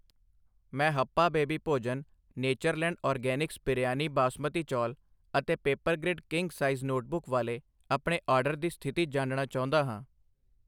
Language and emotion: Punjabi, neutral